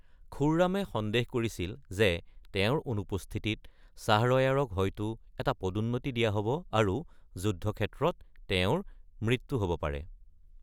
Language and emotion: Assamese, neutral